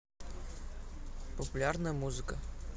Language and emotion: Russian, neutral